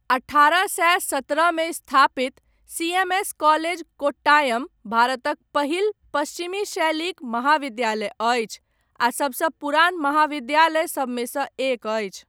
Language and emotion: Maithili, neutral